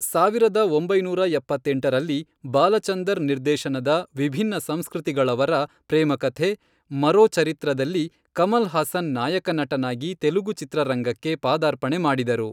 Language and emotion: Kannada, neutral